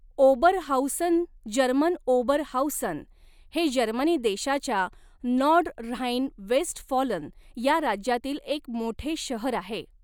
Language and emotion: Marathi, neutral